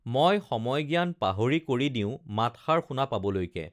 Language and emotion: Assamese, neutral